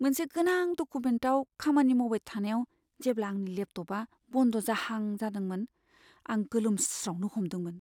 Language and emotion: Bodo, fearful